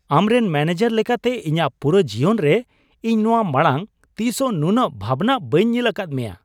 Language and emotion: Santali, surprised